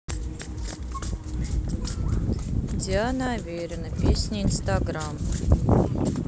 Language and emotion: Russian, neutral